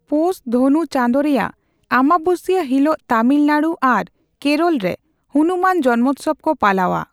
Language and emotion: Santali, neutral